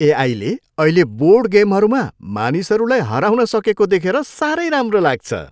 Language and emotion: Nepali, happy